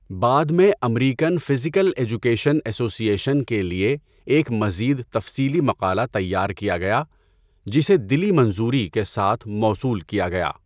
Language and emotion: Urdu, neutral